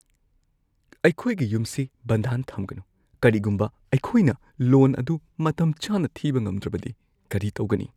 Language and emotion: Manipuri, fearful